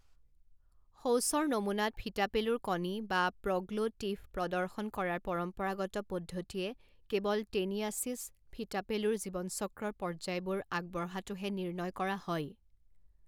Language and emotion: Assamese, neutral